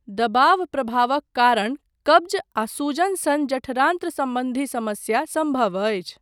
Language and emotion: Maithili, neutral